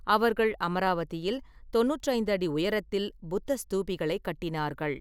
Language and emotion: Tamil, neutral